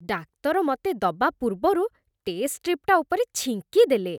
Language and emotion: Odia, disgusted